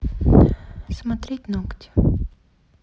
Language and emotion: Russian, neutral